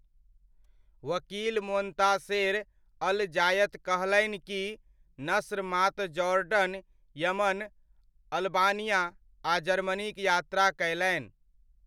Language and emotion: Maithili, neutral